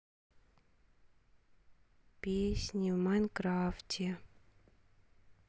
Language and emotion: Russian, neutral